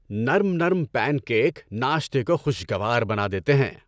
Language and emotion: Urdu, happy